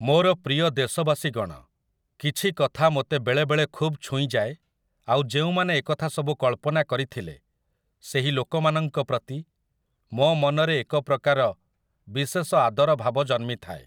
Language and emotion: Odia, neutral